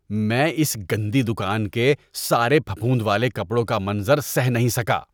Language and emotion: Urdu, disgusted